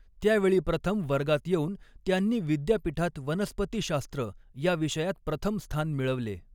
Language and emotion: Marathi, neutral